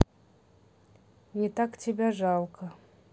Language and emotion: Russian, neutral